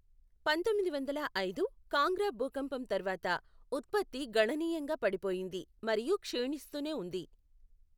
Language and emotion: Telugu, neutral